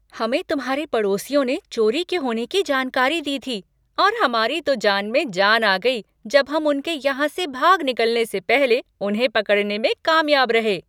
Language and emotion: Hindi, happy